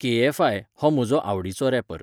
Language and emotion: Goan Konkani, neutral